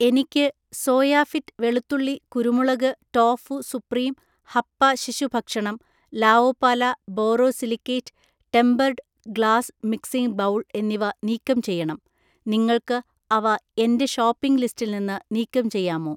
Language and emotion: Malayalam, neutral